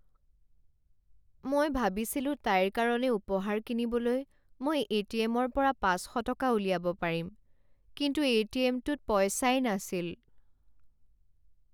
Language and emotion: Assamese, sad